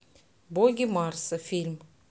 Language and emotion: Russian, neutral